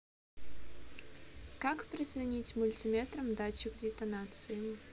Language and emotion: Russian, neutral